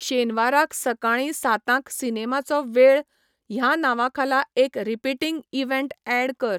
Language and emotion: Goan Konkani, neutral